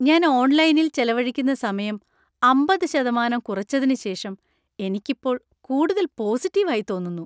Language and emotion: Malayalam, happy